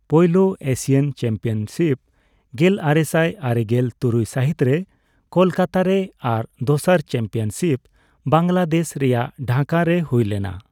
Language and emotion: Santali, neutral